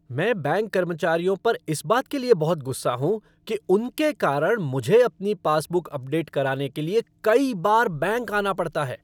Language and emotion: Hindi, angry